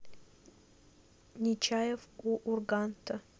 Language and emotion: Russian, neutral